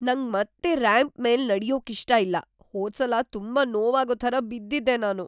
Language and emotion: Kannada, fearful